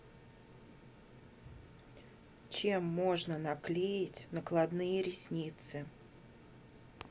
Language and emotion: Russian, neutral